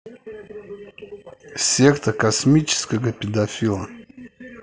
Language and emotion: Russian, neutral